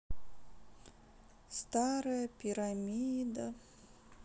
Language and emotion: Russian, sad